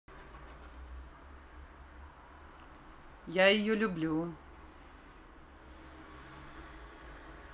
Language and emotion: Russian, positive